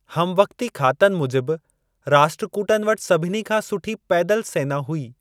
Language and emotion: Sindhi, neutral